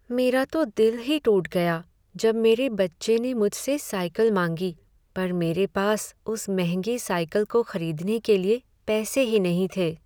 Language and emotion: Hindi, sad